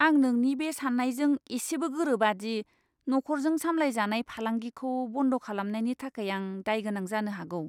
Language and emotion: Bodo, disgusted